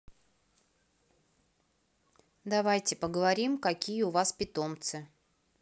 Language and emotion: Russian, neutral